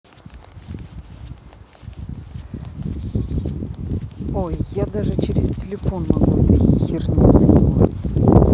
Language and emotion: Russian, angry